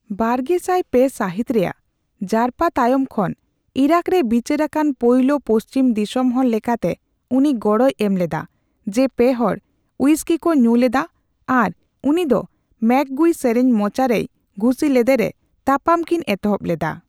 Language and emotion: Santali, neutral